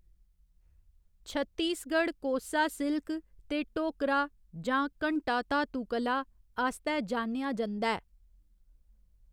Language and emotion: Dogri, neutral